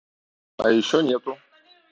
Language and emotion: Russian, neutral